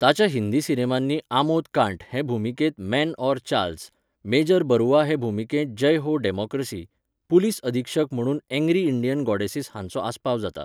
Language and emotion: Goan Konkani, neutral